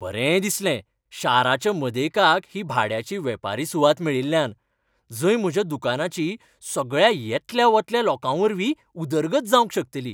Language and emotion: Goan Konkani, happy